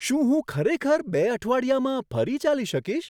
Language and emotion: Gujarati, surprised